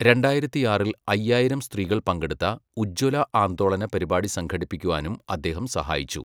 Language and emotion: Malayalam, neutral